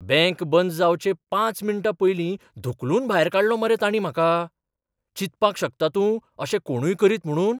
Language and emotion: Goan Konkani, surprised